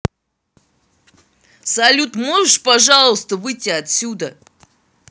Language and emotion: Russian, angry